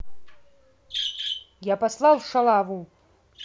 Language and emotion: Russian, angry